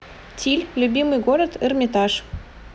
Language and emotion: Russian, neutral